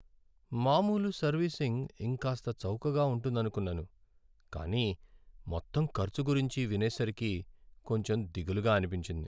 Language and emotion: Telugu, sad